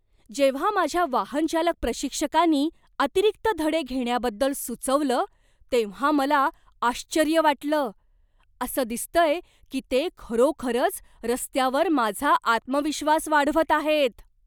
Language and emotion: Marathi, surprised